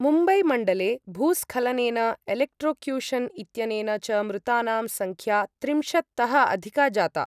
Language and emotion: Sanskrit, neutral